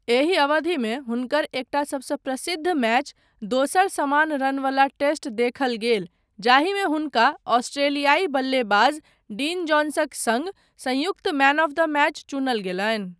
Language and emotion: Maithili, neutral